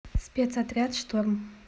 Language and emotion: Russian, neutral